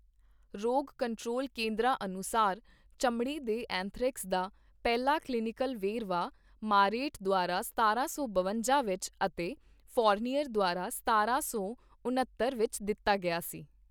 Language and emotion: Punjabi, neutral